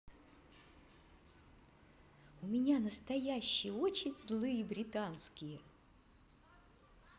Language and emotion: Russian, positive